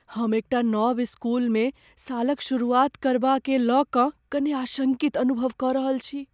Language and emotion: Maithili, fearful